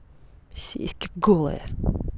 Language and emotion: Russian, angry